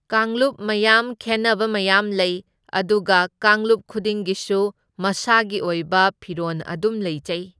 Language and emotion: Manipuri, neutral